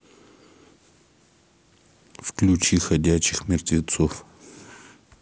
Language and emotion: Russian, neutral